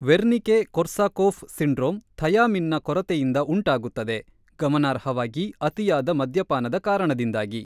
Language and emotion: Kannada, neutral